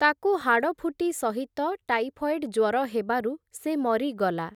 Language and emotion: Odia, neutral